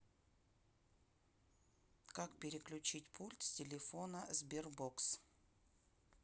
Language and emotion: Russian, neutral